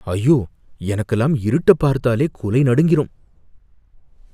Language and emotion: Tamil, fearful